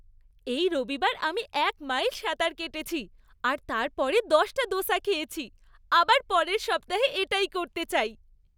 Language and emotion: Bengali, happy